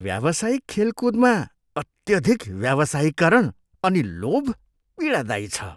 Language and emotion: Nepali, disgusted